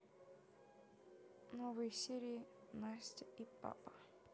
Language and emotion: Russian, neutral